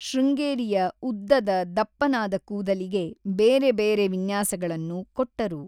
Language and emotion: Kannada, neutral